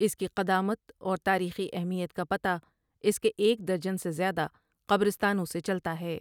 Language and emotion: Urdu, neutral